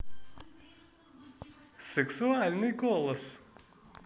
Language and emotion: Russian, positive